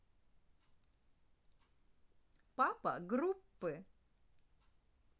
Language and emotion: Russian, positive